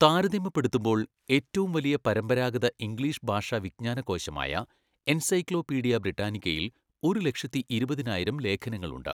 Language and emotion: Malayalam, neutral